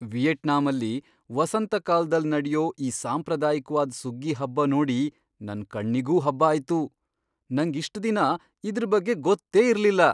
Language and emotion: Kannada, surprised